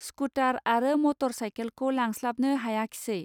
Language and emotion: Bodo, neutral